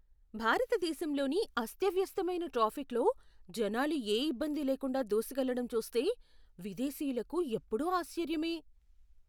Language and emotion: Telugu, surprised